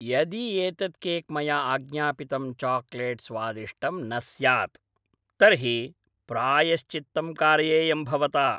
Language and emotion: Sanskrit, angry